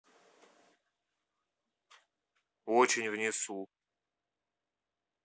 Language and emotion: Russian, neutral